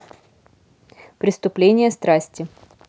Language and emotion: Russian, neutral